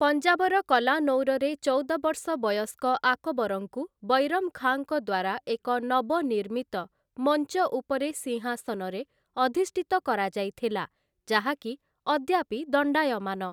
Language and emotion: Odia, neutral